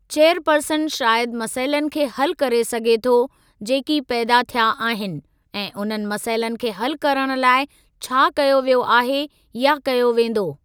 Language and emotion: Sindhi, neutral